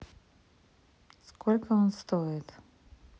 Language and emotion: Russian, neutral